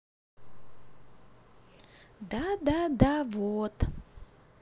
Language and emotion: Russian, neutral